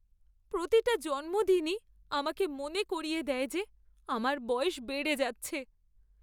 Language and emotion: Bengali, sad